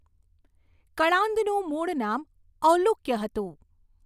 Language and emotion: Gujarati, neutral